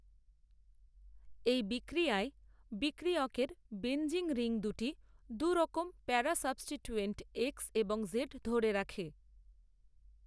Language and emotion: Bengali, neutral